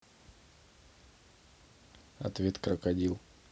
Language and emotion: Russian, neutral